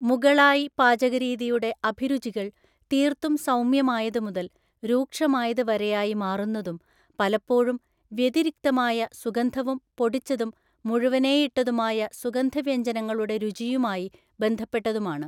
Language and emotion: Malayalam, neutral